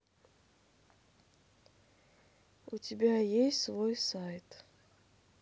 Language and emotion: Russian, sad